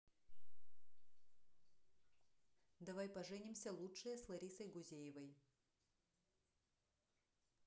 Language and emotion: Russian, neutral